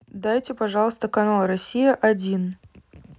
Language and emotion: Russian, neutral